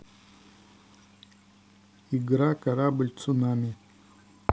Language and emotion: Russian, neutral